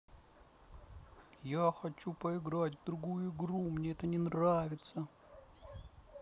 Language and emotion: Russian, sad